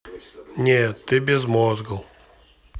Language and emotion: Russian, neutral